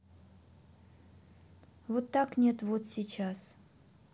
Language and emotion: Russian, sad